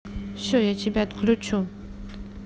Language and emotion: Russian, neutral